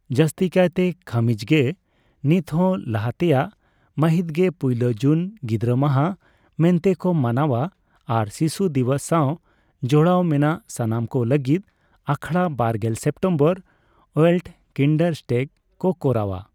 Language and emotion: Santali, neutral